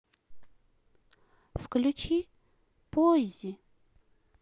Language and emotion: Russian, sad